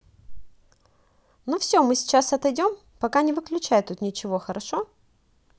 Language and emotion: Russian, positive